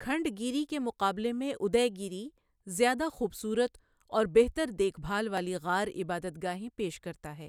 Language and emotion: Urdu, neutral